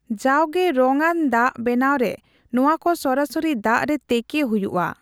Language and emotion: Santali, neutral